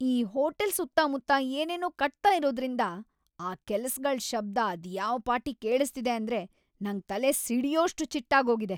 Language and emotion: Kannada, angry